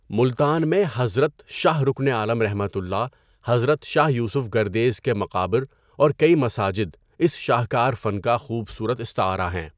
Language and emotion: Urdu, neutral